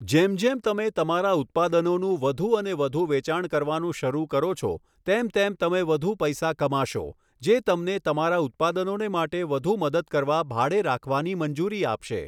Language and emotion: Gujarati, neutral